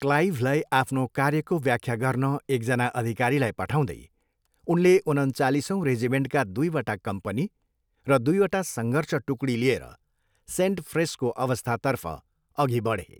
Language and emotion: Nepali, neutral